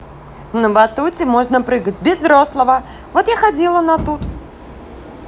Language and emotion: Russian, positive